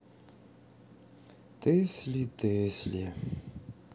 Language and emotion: Russian, sad